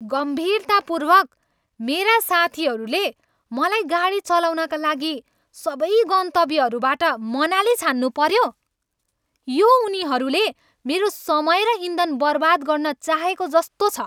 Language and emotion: Nepali, angry